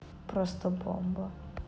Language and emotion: Russian, neutral